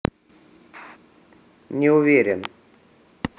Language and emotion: Russian, neutral